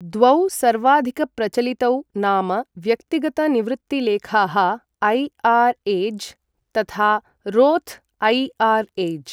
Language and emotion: Sanskrit, neutral